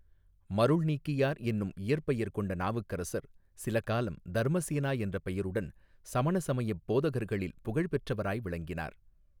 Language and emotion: Tamil, neutral